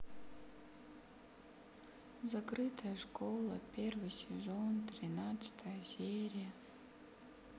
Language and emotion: Russian, sad